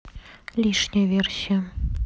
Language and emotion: Russian, neutral